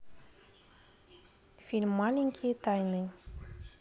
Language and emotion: Russian, neutral